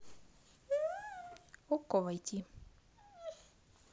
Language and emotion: Russian, neutral